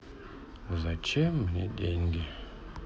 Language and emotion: Russian, sad